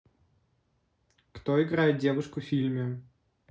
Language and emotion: Russian, neutral